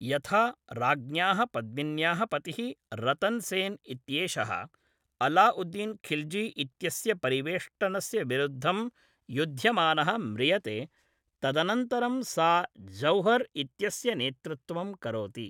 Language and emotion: Sanskrit, neutral